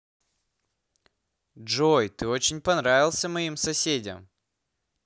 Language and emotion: Russian, positive